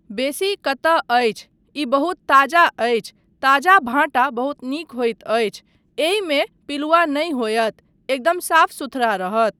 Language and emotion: Maithili, neutral